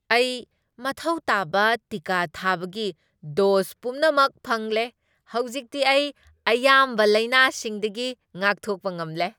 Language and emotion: Manipuri, happy